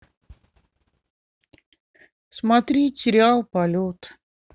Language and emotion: Russian, sad